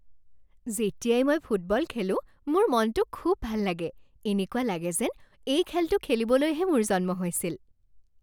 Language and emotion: Assamese, happy